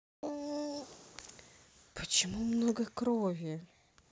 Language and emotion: Russian, neutral